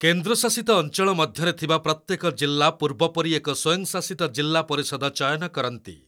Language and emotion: Odia, neutral